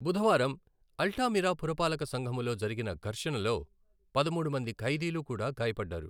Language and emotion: Telugu, neutral